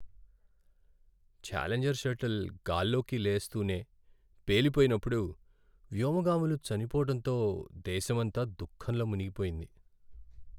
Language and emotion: Telugu, sad